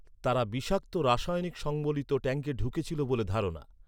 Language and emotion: Bengali, neutral